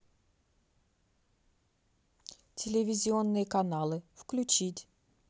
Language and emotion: Russian, neutral